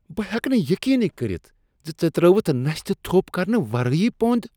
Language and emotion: Kashmiri, disgusted